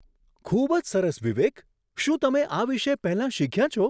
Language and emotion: Gujarati, surprised